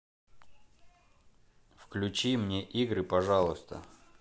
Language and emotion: Russian, neutral